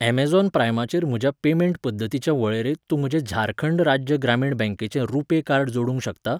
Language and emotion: Goan Konkani, neutral